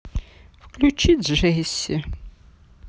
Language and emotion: Russian, sad